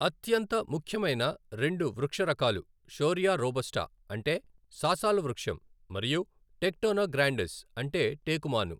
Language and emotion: Telugu, neutral